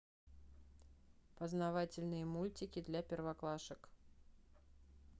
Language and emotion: Russian, neutral